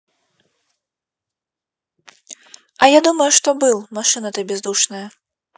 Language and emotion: Russian, neutral